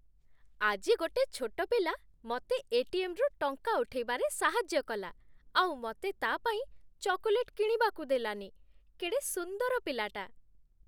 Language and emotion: Odia, happy